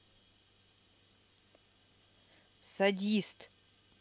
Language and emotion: Russian, angry